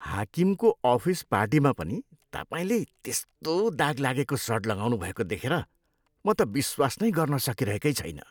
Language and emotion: Nepali, disgusted